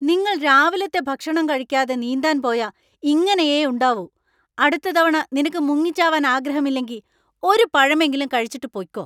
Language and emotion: Malayalam, angry